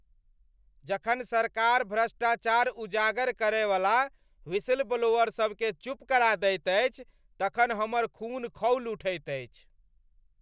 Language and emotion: Maithili, angry